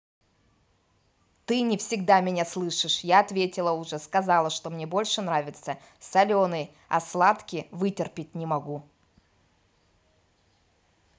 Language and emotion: Russian, angry